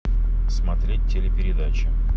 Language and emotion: Russian, neutral